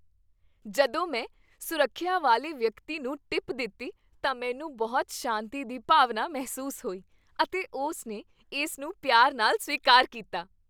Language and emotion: Punjabi, happy